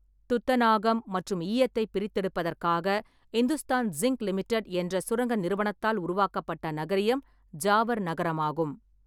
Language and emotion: Tamil, neutral